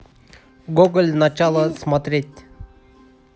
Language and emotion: Russian, neutral